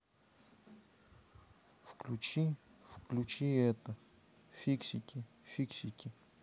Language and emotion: Russian, neutral